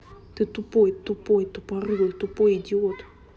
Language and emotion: Russian, angry